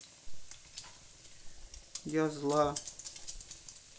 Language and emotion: Russian, sad